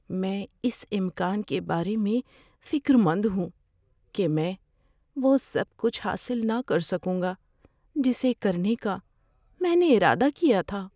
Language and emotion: Urdu, fearful